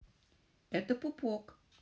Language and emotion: Russian, positive